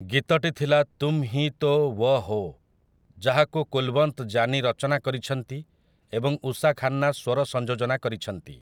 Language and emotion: Odia, neutral